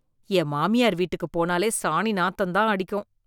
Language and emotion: Tamil, disgusted